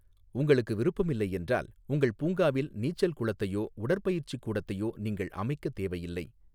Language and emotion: Tamil, neutral